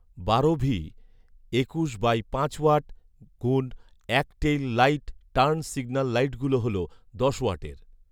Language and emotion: Bengali, neutral